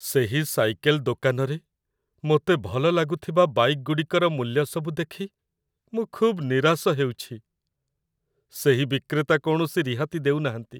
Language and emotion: Odia, sad